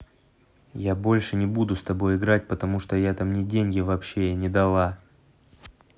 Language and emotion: Russian, neutral